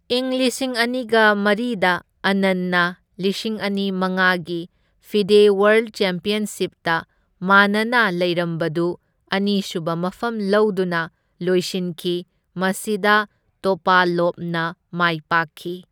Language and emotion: Manipuri, neutral